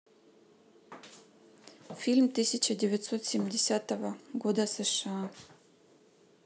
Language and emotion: Russian, neutral